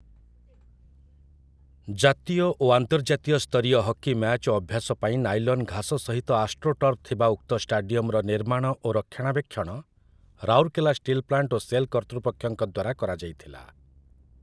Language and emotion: Odia, neutral